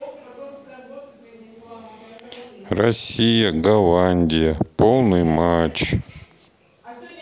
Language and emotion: Russian, neutral